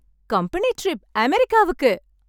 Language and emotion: Tamil, happy